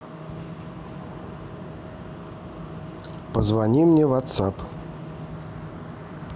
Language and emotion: Russian, neutral